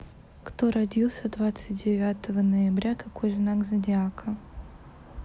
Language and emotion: Russian, neutral